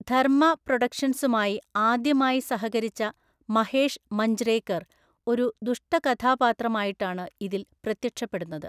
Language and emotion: Malayalam, neutral